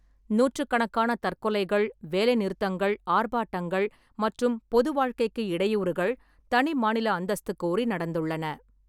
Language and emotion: Tamil, neutral